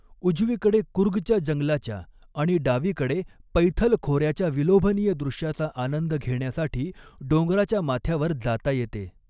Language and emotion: Marathi, neutral